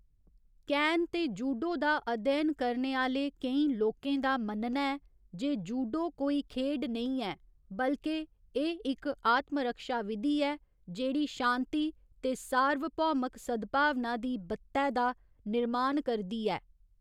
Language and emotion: Dogri, neutral